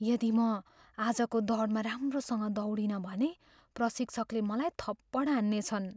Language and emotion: Nepali, fearful